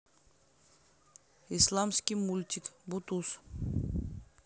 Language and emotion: Russian, neutral